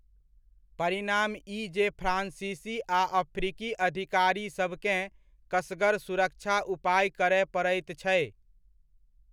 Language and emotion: Maithili, neutral